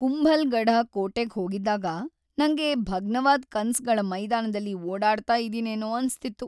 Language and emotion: Kannada, sad